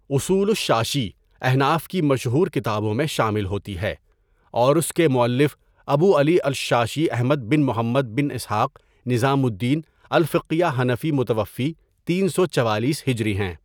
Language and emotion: Urdu, neutral